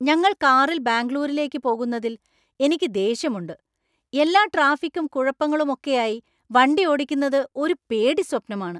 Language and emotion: Malayalam, angry